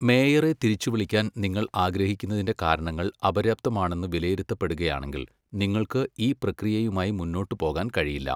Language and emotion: Malayalam, neutral